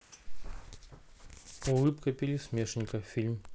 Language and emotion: Russian, neutral